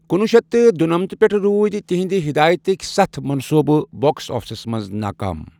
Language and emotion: Kashmiri, neutral